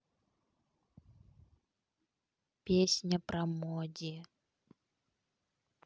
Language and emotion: Russian, neutral